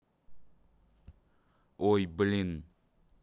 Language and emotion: Russian, neutral